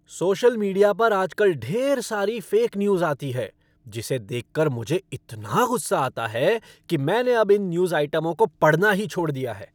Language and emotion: Hindi, angry